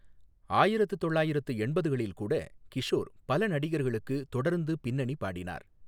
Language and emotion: Tamil, neutral